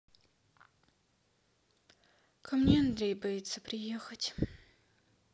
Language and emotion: Russian, sad